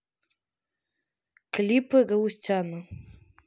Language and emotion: Russian, neutral